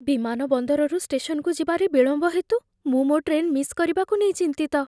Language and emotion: Odia, fearful